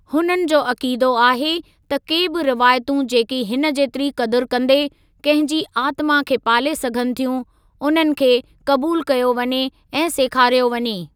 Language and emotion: Sindhi, neutral